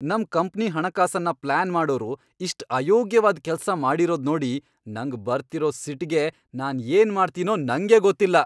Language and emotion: Kannada, angry